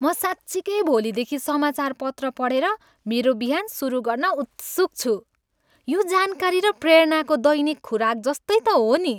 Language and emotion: Nepali, happy